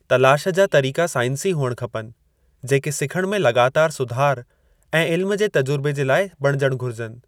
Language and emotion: Sindhi, neutral